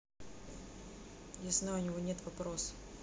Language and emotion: Russian, neutral